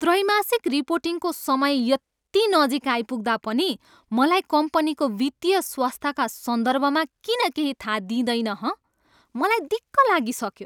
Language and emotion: Nepali, angry